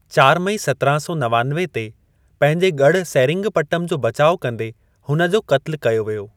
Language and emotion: Sindhi, neutral